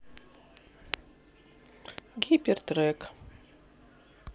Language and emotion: Russian, neutral